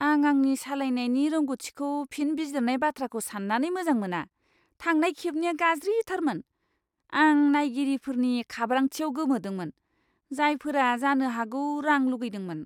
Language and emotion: Bodo, disgusted